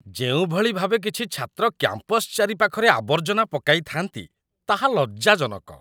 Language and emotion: Odia, disgusted